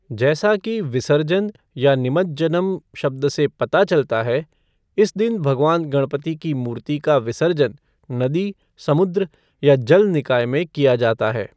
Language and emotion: Hindi, neutral